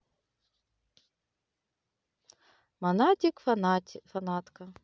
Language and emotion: Russian, neutral